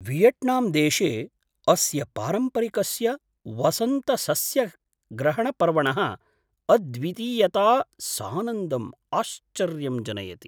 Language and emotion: Sanskrit, surprised